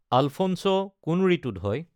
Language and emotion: Assamese, neutral